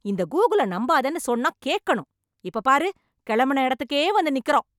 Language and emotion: Tamil, angry